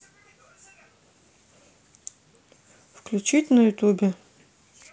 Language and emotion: Russian, neutral